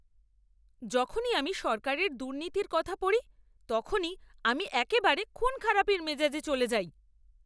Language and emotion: Bengali, angry